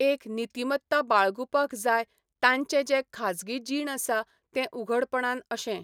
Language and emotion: Goan Konkani, neutral